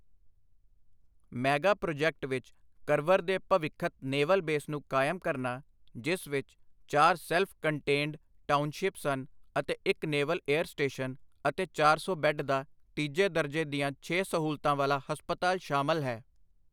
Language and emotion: Punjabi, neutral